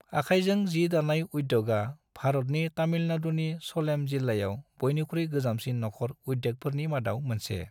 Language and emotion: Bodo, neutral